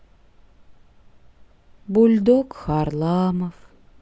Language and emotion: Russian, sad